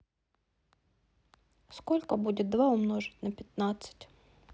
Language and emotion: Russian, neutral